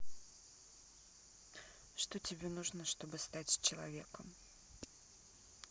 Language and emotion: Russian, neutral